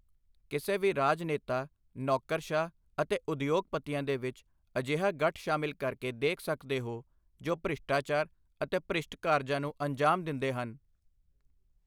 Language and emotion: Punjabi, neutral